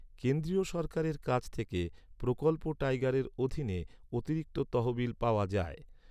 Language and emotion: Bengali, neutral